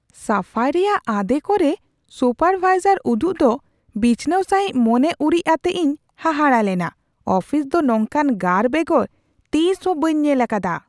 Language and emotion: Santali, surprised